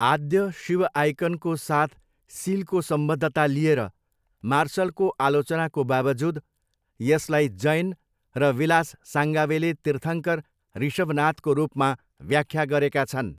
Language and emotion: Nepali, neutral